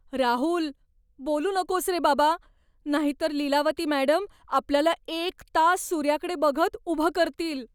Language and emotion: Marathi, fearful